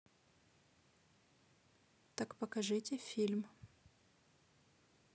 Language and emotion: Russian, neutral